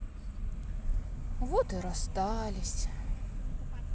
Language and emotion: Russian, sad